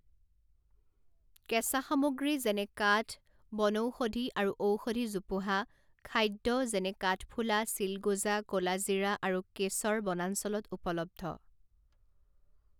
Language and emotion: Assamese, neutral